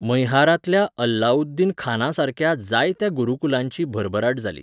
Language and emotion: Goan Konkani, neutral